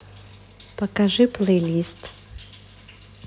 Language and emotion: Russian, neutral